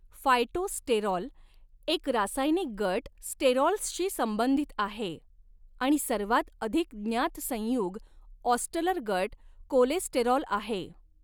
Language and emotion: Marathi, neutral